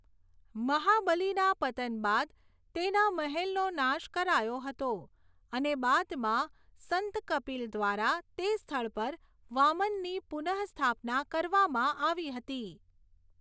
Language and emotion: Gujarati, neutral